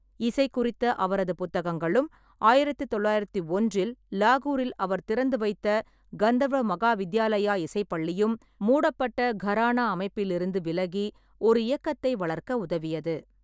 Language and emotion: Tamil, neutral